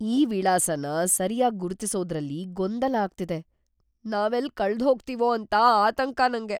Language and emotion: Kannada, fearful